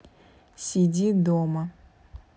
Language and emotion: Russian, neutral